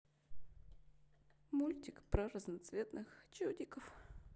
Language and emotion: Russian, sad